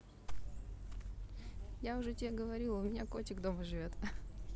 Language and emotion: Russian, positive